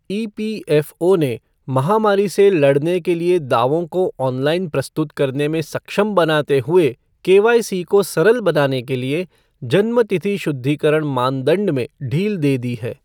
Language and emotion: Hindi, neutral